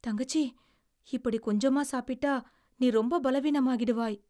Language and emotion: Tamil, fearful